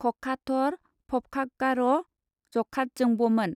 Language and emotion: Bodo, neutral